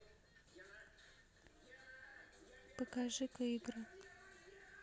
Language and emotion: Russian, neutral